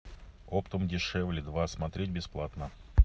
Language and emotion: Russian, neutral